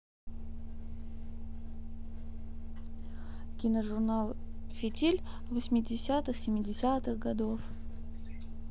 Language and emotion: Russian, neutral